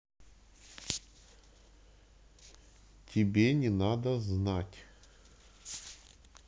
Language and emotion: Russian, neutral